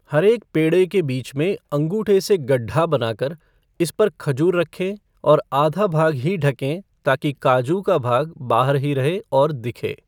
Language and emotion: Hindi, neutral